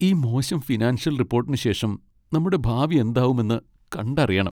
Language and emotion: Malayalam, sad